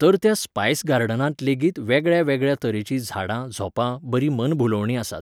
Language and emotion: Goan Konkani, neutral